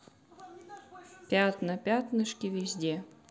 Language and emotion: Russian, neutral